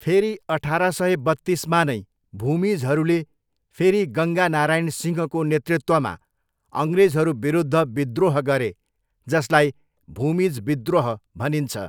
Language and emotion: Nepali, neutral